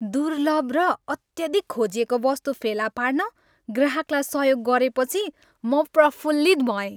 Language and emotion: Nepali, happy